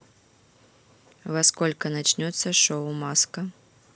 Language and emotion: Russian, neutral